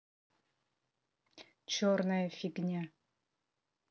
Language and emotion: Russian, angry